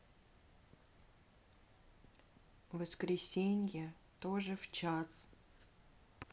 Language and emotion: Russian, sad